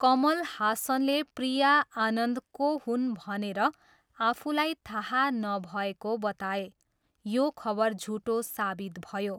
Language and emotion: Nepali, neutral